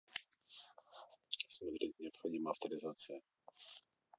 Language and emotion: Russian, neutral